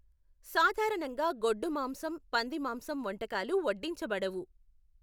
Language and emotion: Telugu, neutral